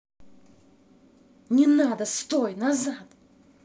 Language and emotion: Russian, angry